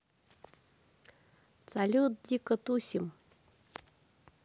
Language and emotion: Russian, positive